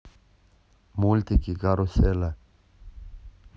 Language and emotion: Russian, neutral